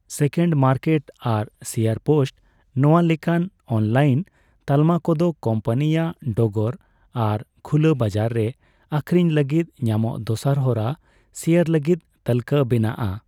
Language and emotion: Santali, neutral